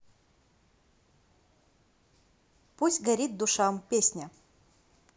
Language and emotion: Russian, neutral